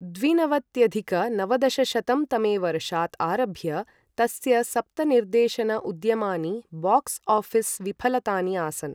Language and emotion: Sanskrit, neutral